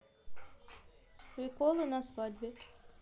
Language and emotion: Russian, neutral